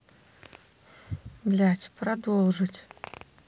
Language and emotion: Russian, neutral